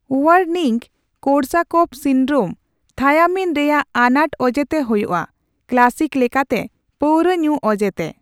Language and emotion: Santali, neutral